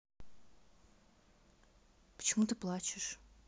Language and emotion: Russian, neutral